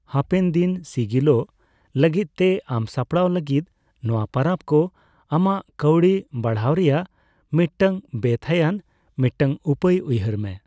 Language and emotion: Santali, neutral